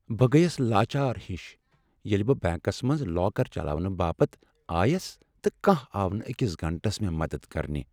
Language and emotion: Kashmiri, sad